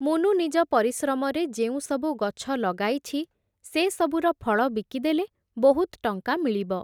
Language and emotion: Odia, neutral